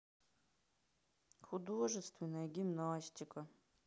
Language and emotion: Russian, sad